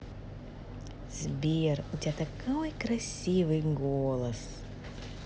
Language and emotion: Russian, positive